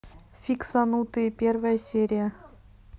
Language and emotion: Russian, neutral